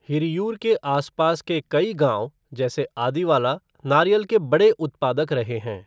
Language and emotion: Hindi, neutral